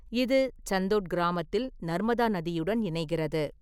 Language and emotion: Tamil, neutral